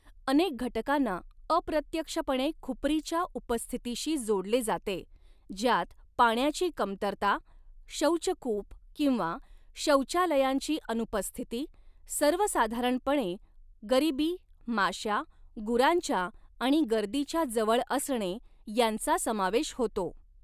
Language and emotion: Marathi, neutral